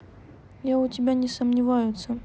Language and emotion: Russian, neutral